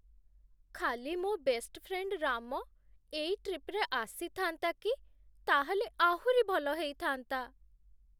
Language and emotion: Odia, sad